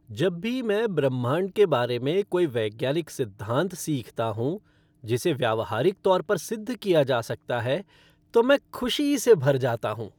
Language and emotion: Hindi, happy